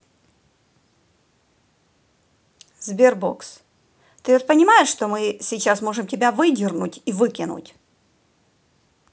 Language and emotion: Russian, angry